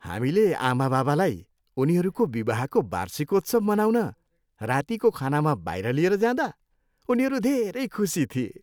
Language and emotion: Nepali, happy